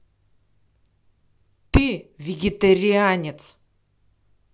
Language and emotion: Russian, angry